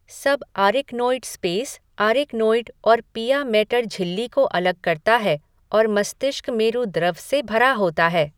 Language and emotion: Hindi, neutral